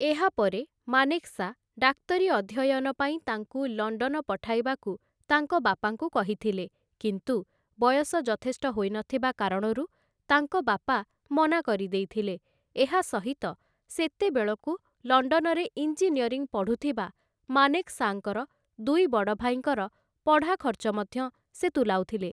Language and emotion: Odia, neutral